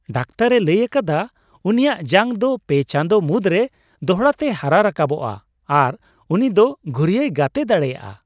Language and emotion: Santali, happy